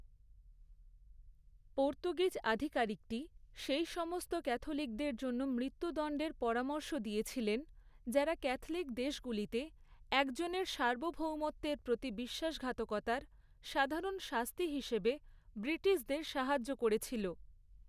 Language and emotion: Bengali, neutral